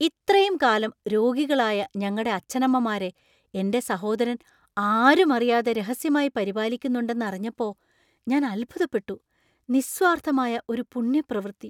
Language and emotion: Malayalam, surprised